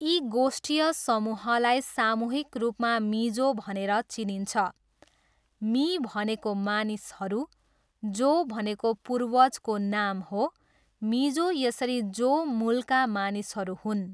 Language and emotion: Nepali, neutral